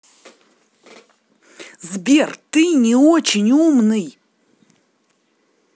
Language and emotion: Russian, angry